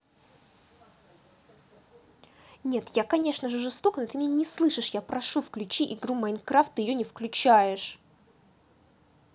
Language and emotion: Russian, angry